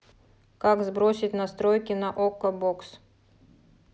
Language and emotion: Russian, neutral